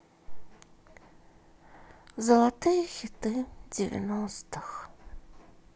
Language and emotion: Russian, sad